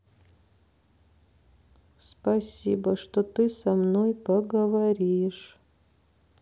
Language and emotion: Russian, sad